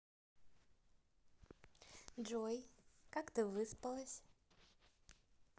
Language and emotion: Russian, positive